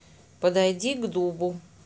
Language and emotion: Russian, neutral